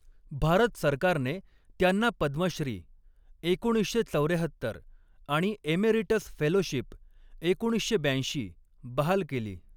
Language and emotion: Marathi, neutral